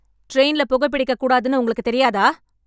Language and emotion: Tamil, angry